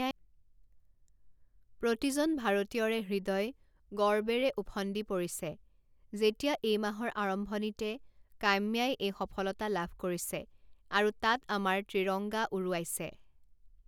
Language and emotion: Assamese, neutral